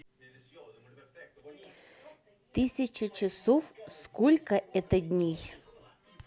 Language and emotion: Russian, neutral